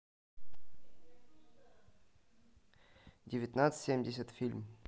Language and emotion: Russian, neutral